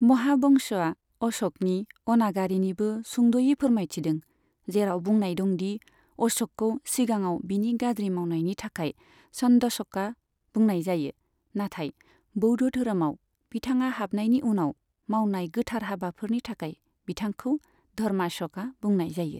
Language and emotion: Bodo, neutral